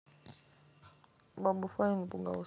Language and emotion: Russian, neutral